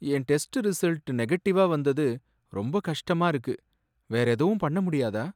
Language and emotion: Tamil, sad